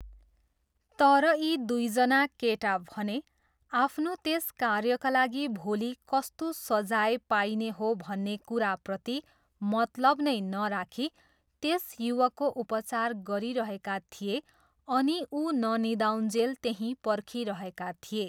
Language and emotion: Nepali, neutral